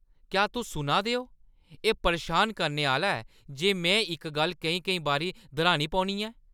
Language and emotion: Dogri, angry